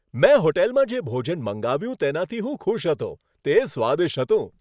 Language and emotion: Gujarati, happy